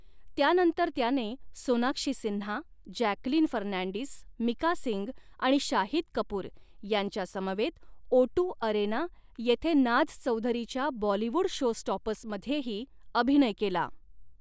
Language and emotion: Marathi, neutral